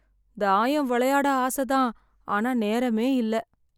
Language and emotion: Tamil, sad